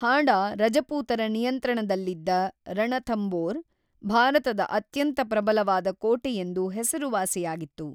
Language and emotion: Kannada, neutral